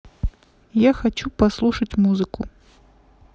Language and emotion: Russian, neutral